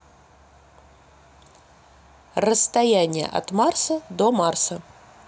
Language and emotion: Russian, neutral